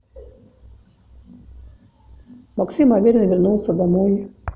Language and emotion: Russian, neutral